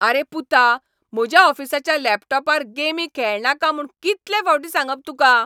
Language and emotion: Goan Konkani, angry